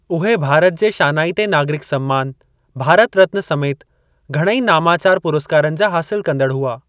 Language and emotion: Sindhi, neutral